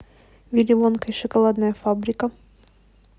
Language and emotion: Russian, neutral